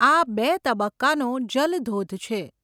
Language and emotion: Gujarati, neutral